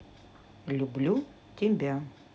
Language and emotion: Russian, neutral